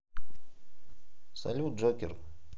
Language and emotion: Russian, neutral